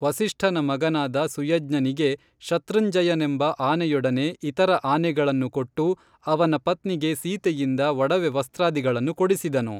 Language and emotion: Kannada, neutral